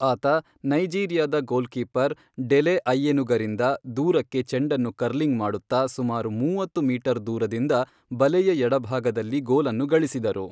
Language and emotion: Kannada, neutral